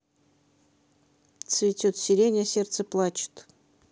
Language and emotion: Russian, neutral